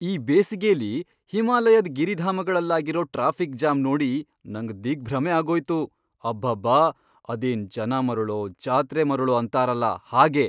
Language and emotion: Kannada, surprised